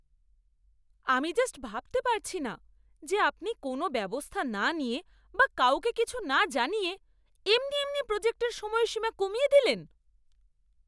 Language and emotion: Bengali, angry